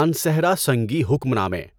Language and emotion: Urdu, neutral